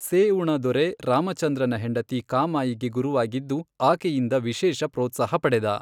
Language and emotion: Kannada, neutral